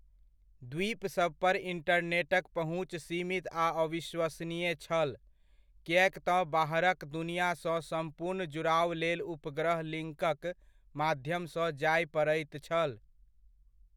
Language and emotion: Maithili, neutral